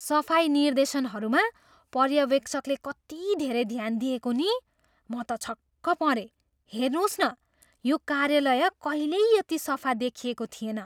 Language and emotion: Nepali, surprised